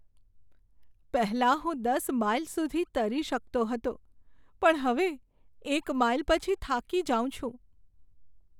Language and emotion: Gujarati, sad